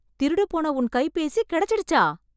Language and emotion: Tamil, surprised